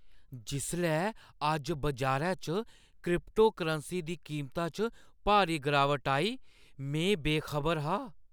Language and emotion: Dogri, surprised